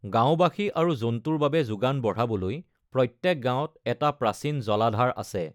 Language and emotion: Assamese, neutral